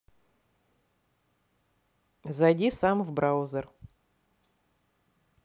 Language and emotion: Russian, neutral